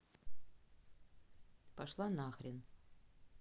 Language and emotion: Russian, angry